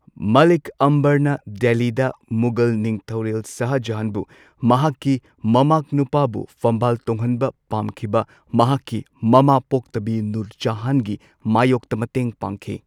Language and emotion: Manipuri, neutral